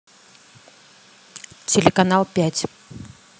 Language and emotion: Russian, neutral